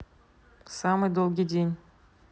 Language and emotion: Russian, neutral